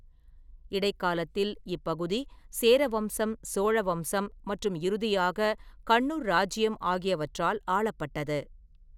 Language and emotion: Tamil, neutral